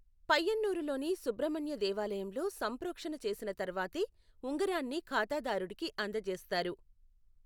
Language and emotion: Telugu, neutral